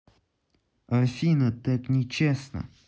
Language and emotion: Russian, neutral